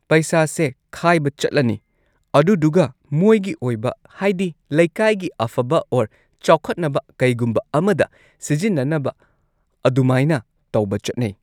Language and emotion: Manipuri, neutral